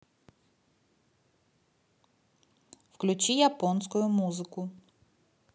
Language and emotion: Russian, neutral